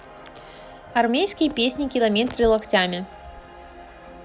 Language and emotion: Russian, neutral